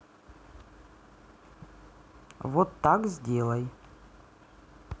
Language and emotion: Russian, neutral